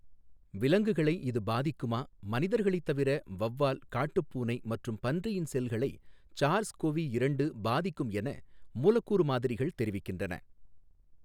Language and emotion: Tamil, neutral